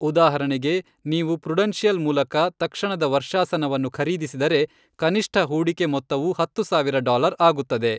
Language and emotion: Kannada, neutral